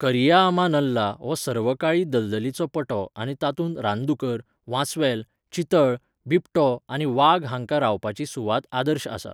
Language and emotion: Goan Konkani, neutral